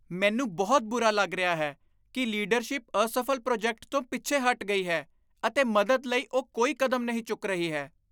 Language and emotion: Punjabi, disgusted